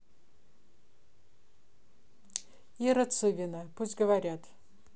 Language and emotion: Russian, neutral